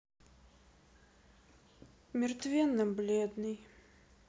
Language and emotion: Russian, sad